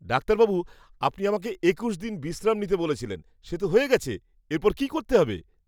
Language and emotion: Bengali, happy